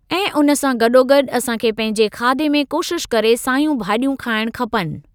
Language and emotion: Sindhi, neutral